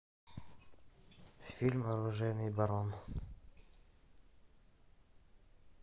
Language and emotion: Russian, neutral